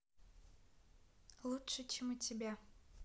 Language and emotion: Russian, neutral